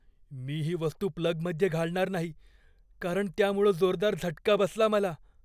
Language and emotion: Marathi, fearful